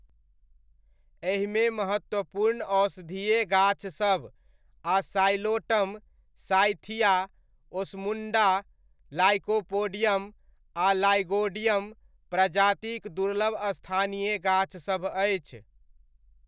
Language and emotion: Maithili, neutral